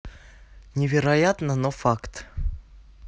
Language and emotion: Russian, neutral